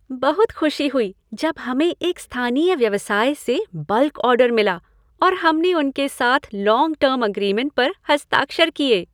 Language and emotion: Hindi, happy